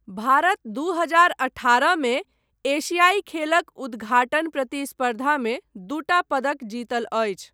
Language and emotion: Maithili, neutral